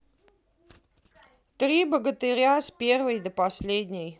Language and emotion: Russian, neutral